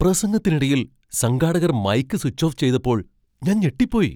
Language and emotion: Malayalam, surprised